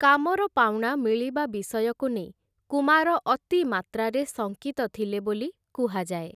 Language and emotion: Odia, neutral